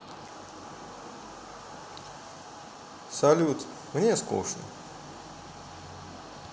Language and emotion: Russian, sad